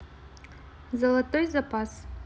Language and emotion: Russian, neutral